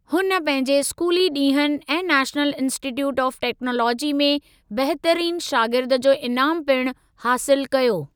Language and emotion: Sindhi, neutral